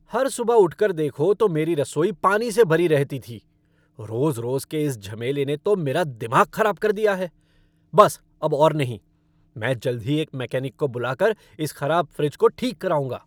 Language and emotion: Hindi, angry